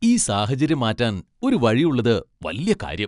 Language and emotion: Malayalam, happy